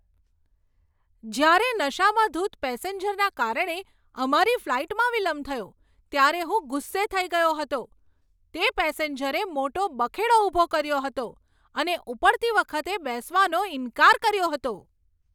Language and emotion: Gujarati, angry